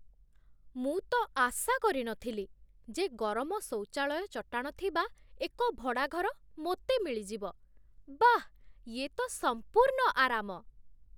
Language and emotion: Odia, surprised